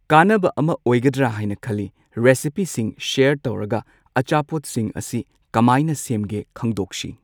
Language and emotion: Manipuri, neutral